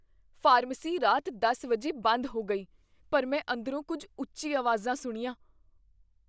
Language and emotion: Punjabi, fearful